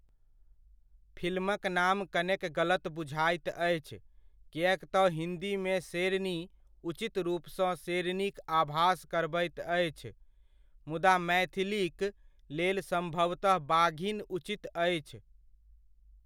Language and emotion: Maithili, neutral